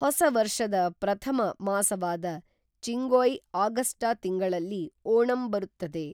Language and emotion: Kannada, neutral